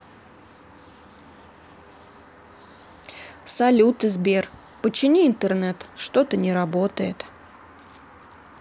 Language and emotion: Russian, sad